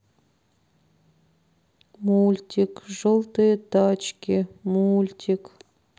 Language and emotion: Russian, sad